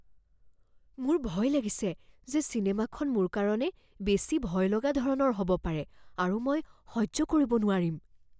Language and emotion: Assamese, fearful